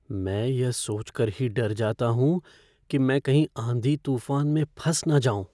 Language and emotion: Hindi, fearful